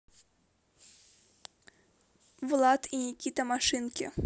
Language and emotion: Russian, neutral